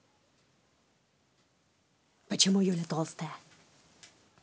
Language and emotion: Russian, angry